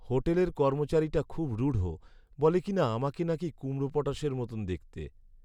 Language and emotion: Bengali, sad